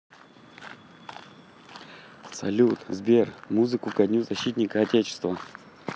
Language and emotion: Russian, positive